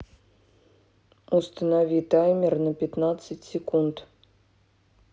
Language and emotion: Russian, neutral